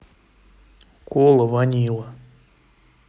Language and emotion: Russian, neutral